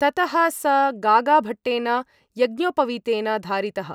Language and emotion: Sanskrit, neutral